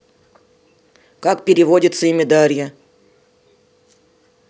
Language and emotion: Russian, neutral